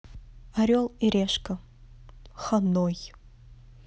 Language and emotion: Russian, neutral